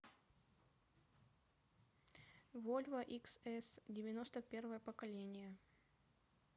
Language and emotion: Russian, neutral